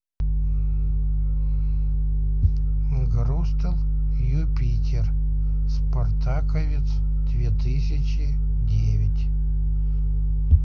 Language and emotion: Russian, neutral